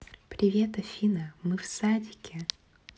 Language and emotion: Russian, neutral